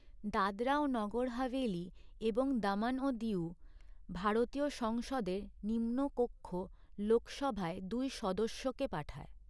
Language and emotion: Bengali, neutral